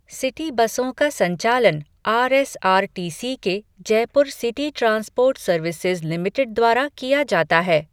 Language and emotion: Hindi, neutral